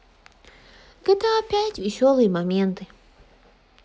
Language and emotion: Russian, sad